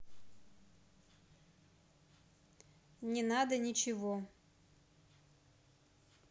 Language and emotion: Russian, neutral